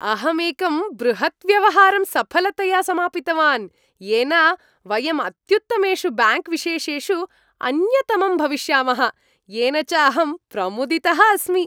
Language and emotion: Sanskrit, happy